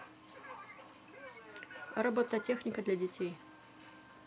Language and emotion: Russian, neutral